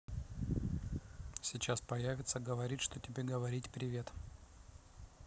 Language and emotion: Russian, neutral